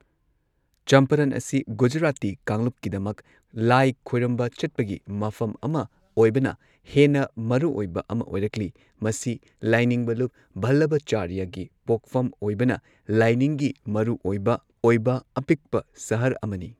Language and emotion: Manipuri, neutral